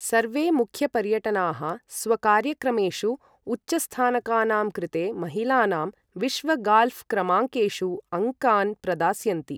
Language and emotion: Sanskrit, neutral